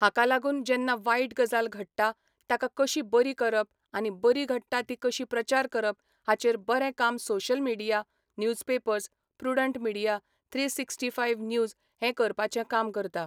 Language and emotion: Goan Konkani, neutral